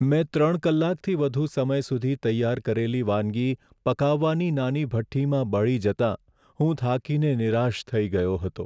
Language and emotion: Gujarati, sad